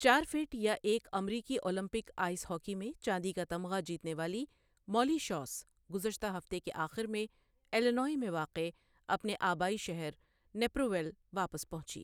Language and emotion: Urdu, neutral